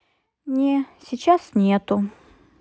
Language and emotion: Russian, sad